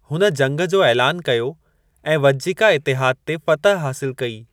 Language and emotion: Sindhi, neutral